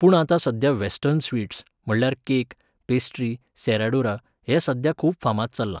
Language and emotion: Goan Konkani, neutral